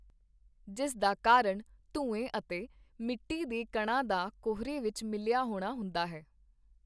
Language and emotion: Punjabi, neutral